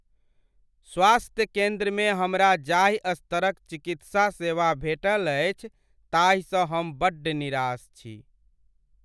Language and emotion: Maithili, sad